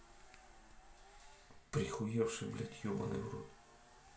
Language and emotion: Russian, angry